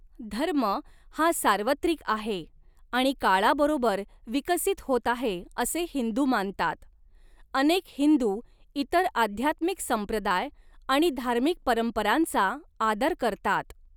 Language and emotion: Marathi, neutral